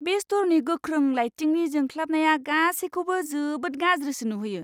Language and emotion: Bodo, disgusted